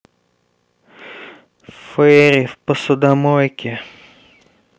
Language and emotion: Russian, sad